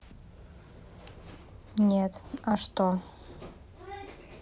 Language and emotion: Russian, neutral